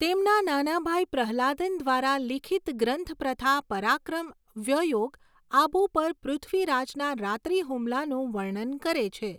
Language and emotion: Gujarati, neutral